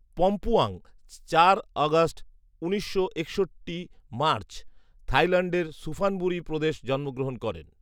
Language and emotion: Bengali, neutral